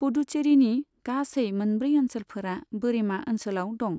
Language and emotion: Bodo, neutral